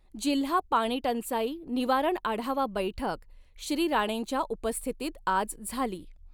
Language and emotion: Marathi, neutral